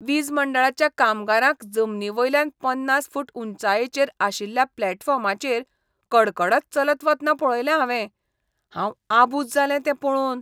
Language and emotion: Goan Konkani, disgusted